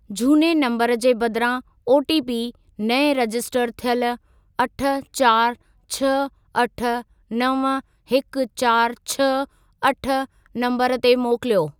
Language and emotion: Sindhi, neutral